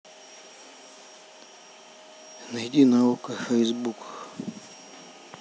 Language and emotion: Russian, neutral